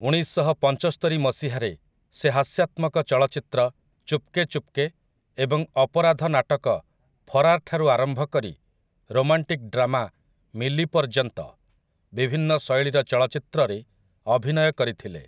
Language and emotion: Odia, neutral